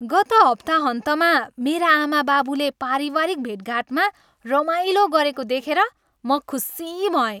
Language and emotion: Nepali, happy